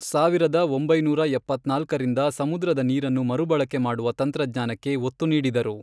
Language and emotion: Kannada, neutral